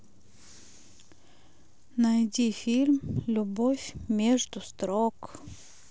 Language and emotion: Russian, sad